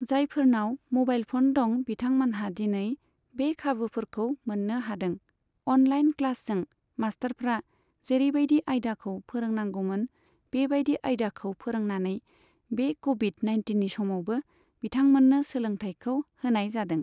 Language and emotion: Bodo, neutral